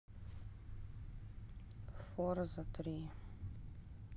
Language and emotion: Russian, sad